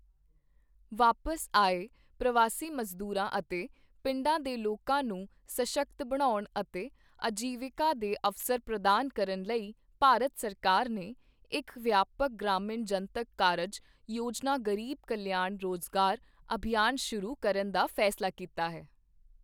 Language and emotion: Punjabi, neutral